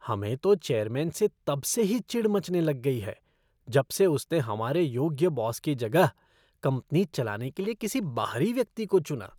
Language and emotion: Hindi, disgusted